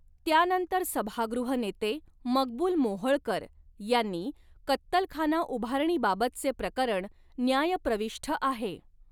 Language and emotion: Marathi, neutral